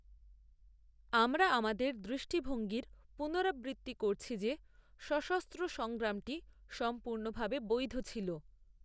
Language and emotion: Bengali, neutral